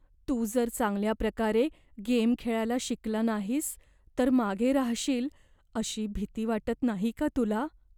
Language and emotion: Marathi, fearful